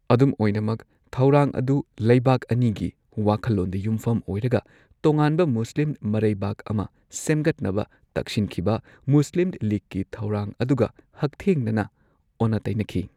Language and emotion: Manipuri, neutral